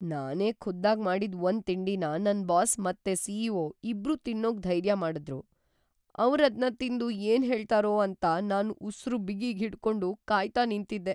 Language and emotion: Kannada, fearful